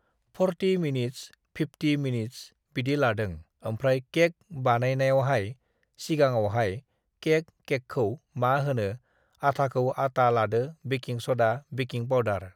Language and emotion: Bodo, neutral